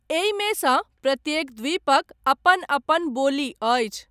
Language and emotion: Maithili, neutral